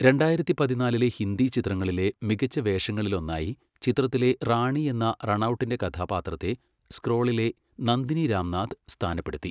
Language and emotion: Malayalam, neutral